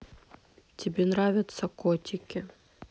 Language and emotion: Russian, sad